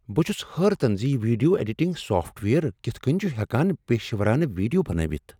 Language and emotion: Kashmiri, surprised